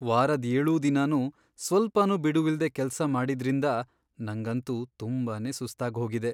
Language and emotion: Kannada, sad